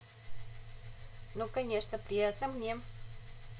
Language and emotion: Russian, positive